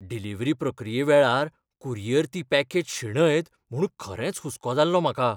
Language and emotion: Goan Konkani, fearful